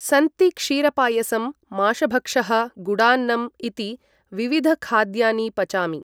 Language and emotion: Sanskrit, neutral